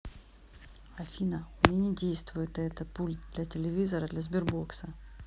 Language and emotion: Russian, neutral